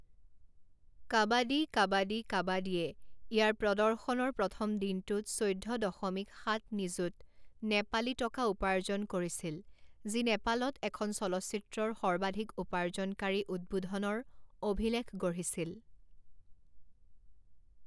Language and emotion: Assamese, neutral